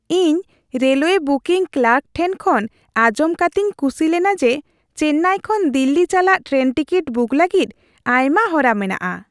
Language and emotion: Santali, happy